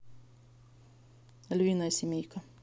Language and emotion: Russian, neutral